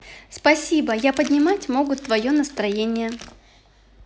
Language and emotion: Russian, positive